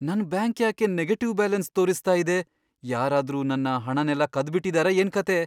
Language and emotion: Kannada, fearful